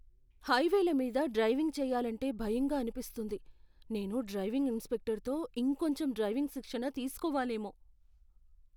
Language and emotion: Telugu, fearful